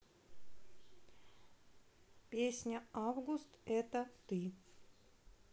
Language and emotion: Russian, neutral